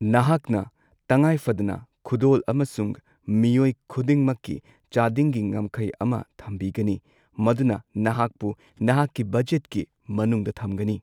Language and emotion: Manipuri, neutral